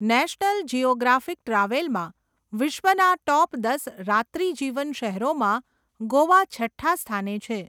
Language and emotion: Gujarati, neutral